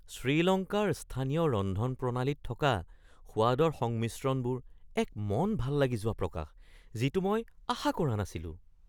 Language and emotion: Assamese, surprised